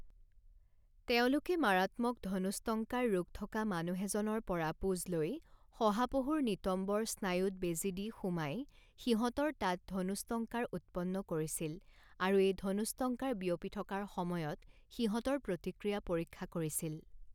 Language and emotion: Assamese, neutral